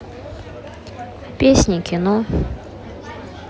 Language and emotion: Russian, neutral